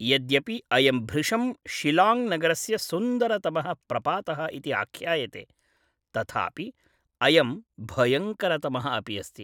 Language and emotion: Sanskrit, neutral